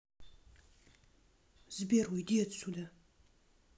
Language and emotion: Russian, angry